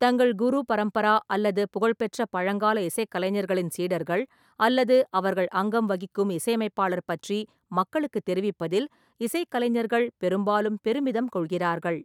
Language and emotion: Tamil, neutral